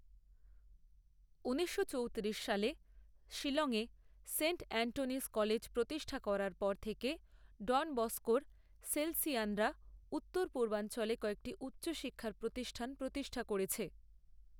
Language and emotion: Bengali, neutral